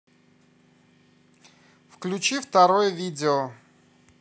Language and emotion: Russian, neutral